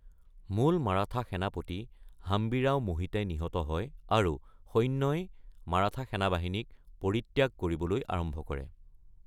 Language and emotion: Assamese, neutral